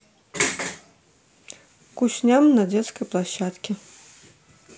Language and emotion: Russian, neutral